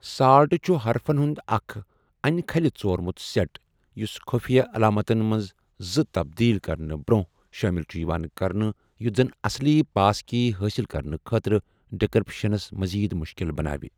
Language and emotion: Kashmiri, neutral